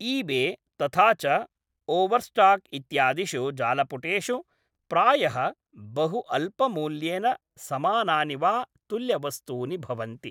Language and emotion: Sanskrit, neutral